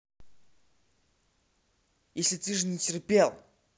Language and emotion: Russian, angry